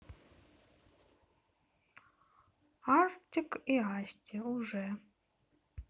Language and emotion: Russian, neutral